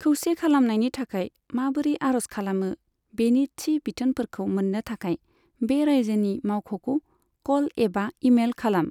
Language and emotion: Bodo, neutral